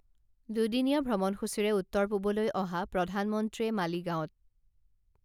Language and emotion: Assamese, neutral